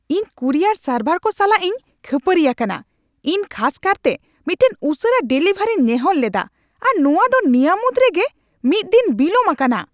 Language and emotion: Santali, angry